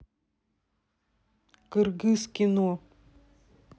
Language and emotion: Russian, neutral